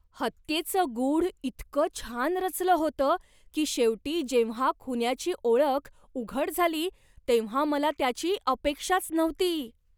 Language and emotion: Marathi, surprised